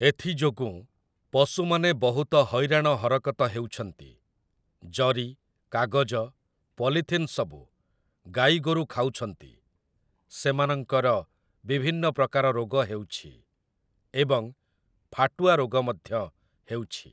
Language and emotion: Odia, neutral